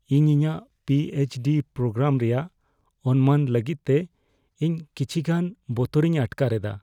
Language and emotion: Santali, fearful